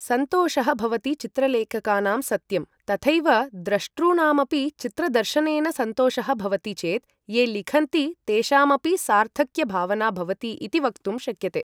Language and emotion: Sanskrit, neutral